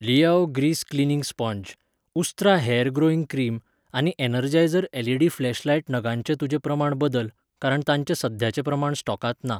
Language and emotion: Goan Konkani, neutral